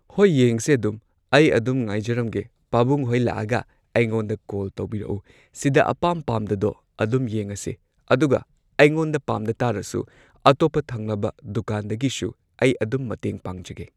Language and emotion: Manipuri, neutral